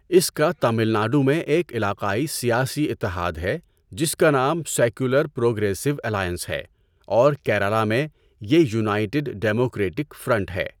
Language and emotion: Urdu, neutral